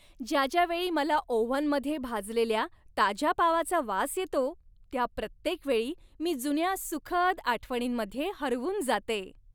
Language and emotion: Marathi, happy